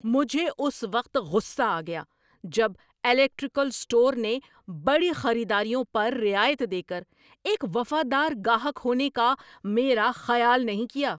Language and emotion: Urdu, angry